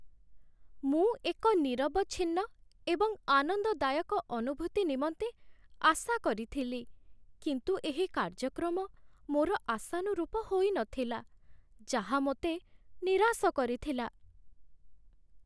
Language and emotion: Odia, sad